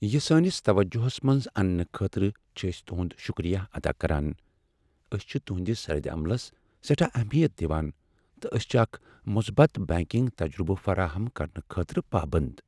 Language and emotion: Kashmiri, sad